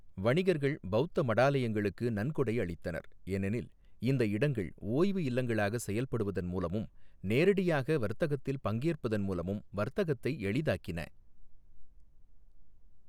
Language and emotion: Tamil, neutral